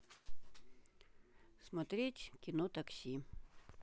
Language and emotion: Russian, neutral